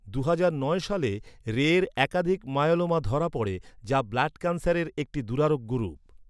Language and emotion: Bengali, neutral